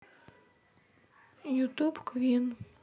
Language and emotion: Russian, sad